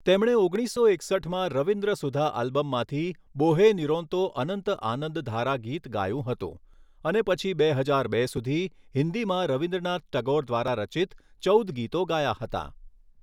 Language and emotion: Gujarati, neutral